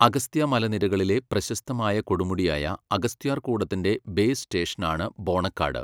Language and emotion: Malayalam, neutral